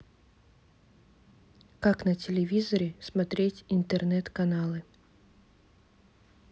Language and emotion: Russian, neutral